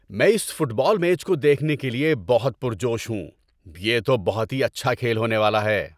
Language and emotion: Urdu, happy